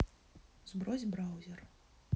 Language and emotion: Russian, neutral